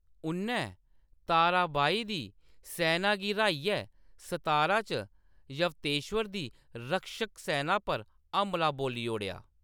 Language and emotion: Dogri, neutral